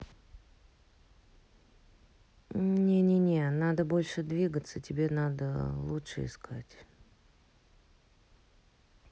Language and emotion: Russian, neutral